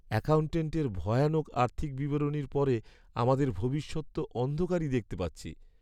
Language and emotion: Bengali, sad